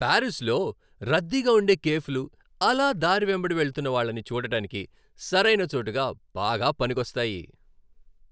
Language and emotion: Telugu, happy